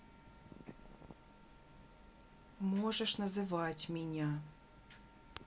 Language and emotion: Russian, angry